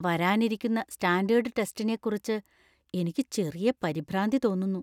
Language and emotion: Malayalam, fearful